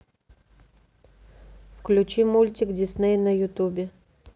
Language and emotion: Russian, neutral